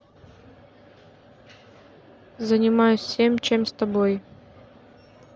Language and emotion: Russian, neutral